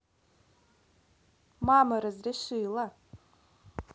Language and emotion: Russian, positive